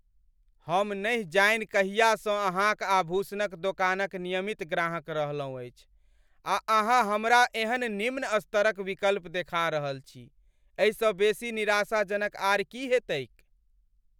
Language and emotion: Maithili, angry